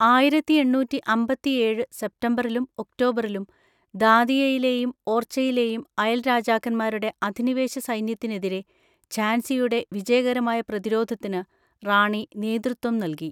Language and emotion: Malayalam, neutral